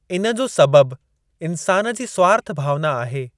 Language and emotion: Sindhi, neutral